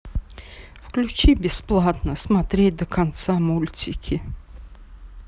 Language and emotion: Russian, sad